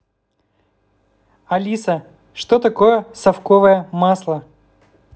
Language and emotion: Russian, neutral